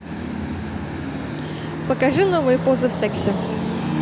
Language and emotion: Russian, positive